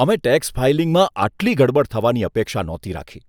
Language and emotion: Gujarati, disgusted